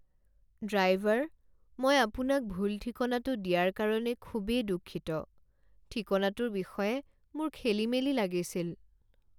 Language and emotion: Assamese, sad